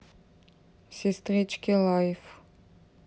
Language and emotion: Russian, neutral